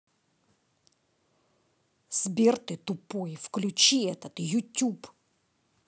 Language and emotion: Russian, angry